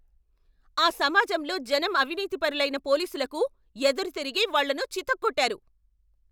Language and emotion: Telugu, angry